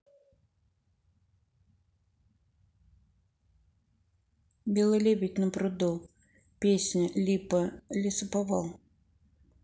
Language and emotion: Russian, neutral